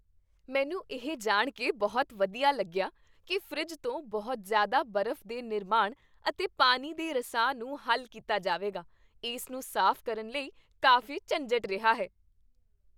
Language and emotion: Punjabi, happy